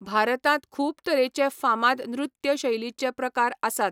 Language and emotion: Goan Konkani, neutral